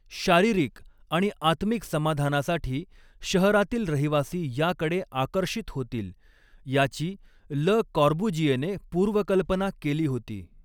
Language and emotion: Marathi, neutral